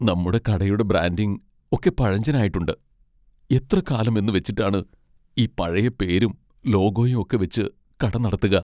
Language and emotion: Malayalam, sad